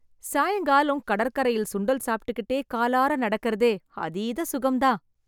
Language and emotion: Tamil, happy